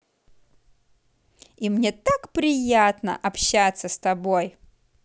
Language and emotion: Russian, positive